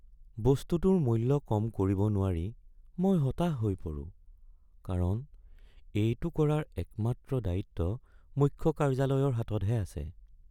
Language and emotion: Assamese, sad